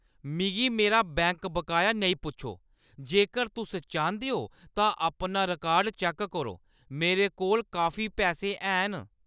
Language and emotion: Dogri, angry